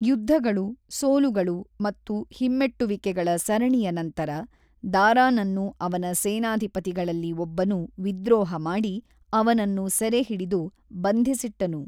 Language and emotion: Kannada, neutral